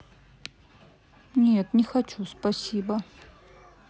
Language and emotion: Russian, sad